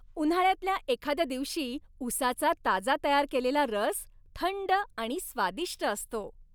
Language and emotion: Marathi, happy